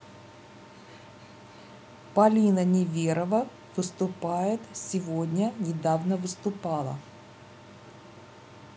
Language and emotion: Russian, neutral